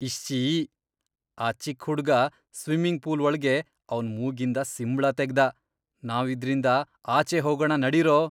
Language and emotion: Kannada, disgusted